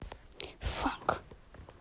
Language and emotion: Russian, angry